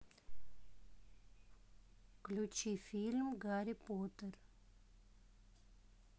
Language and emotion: Russian, neutral